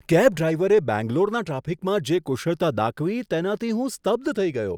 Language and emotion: Gujarati, surprised